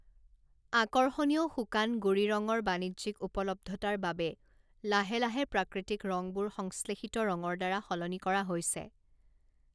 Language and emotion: Assamese, neutral